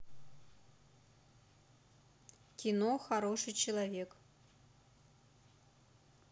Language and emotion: Russian, neutral